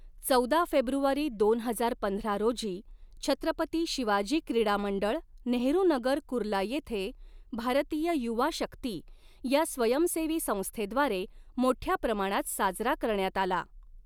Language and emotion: Marathi, neutral